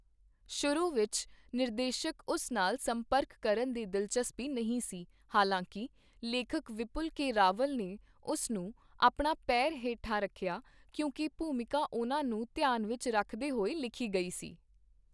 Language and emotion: Punjabi, neutral